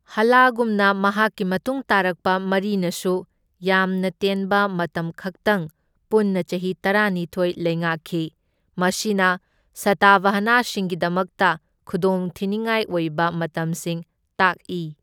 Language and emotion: Manipuri, neutral